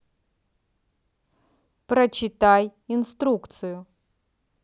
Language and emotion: Russian, neutral